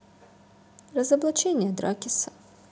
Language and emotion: Russian, neutral